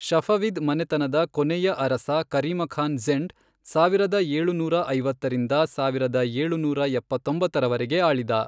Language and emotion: Kannada, neutral